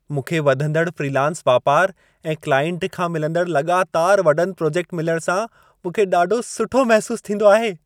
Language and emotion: Sindhi, happy